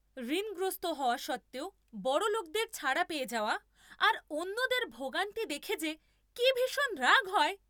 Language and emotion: Bengali, angry